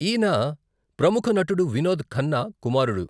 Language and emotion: Telugu, neutral